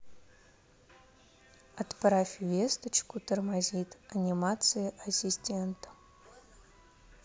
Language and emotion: Russian, neutral